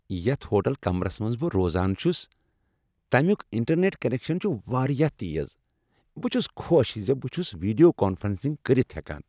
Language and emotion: Kashmiri, happy